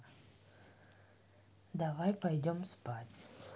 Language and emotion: Russian, neutral